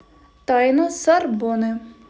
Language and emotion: Russian, neutral